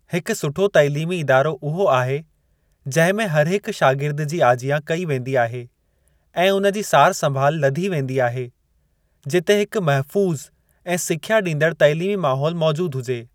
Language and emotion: Sindhi, neutral